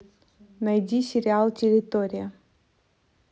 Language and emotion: Russian, neutral